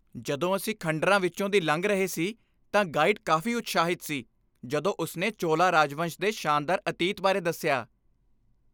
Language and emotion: Punjabi, happy